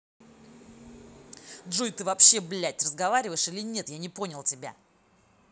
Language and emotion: Russian, angry